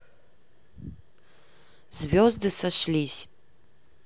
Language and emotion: Russian, neutral